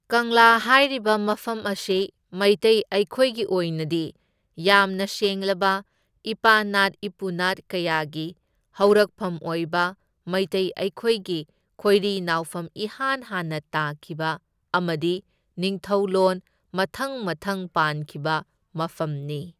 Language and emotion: Manipuri, neutral